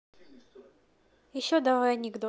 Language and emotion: Russian, neutral